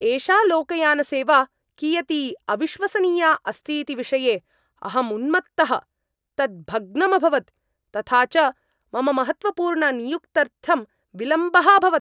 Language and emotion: Sanskrit, angry